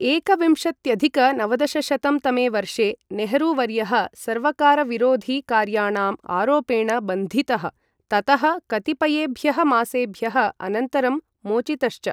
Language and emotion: Sanskrit, neutral